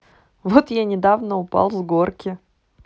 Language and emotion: Russian, neutral